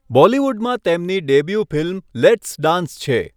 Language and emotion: Gujarati, neutral